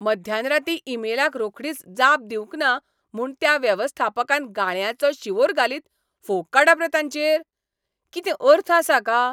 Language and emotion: Goan Konkani, angry